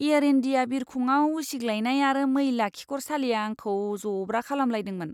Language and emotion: Bodo, disgusted